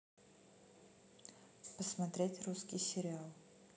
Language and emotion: Russian, neutral